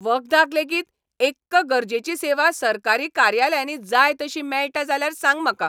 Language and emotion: Goan Konkani, angry